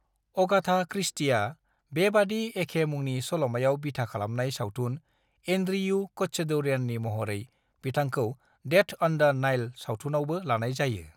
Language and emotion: Bodo, neutral